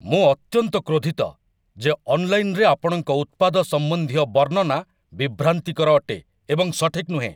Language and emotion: Odia, angry